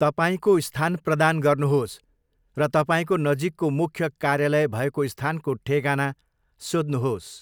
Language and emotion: Nepali, neutral